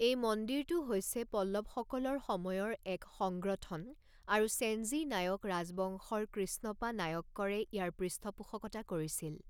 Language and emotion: Assamese, neutral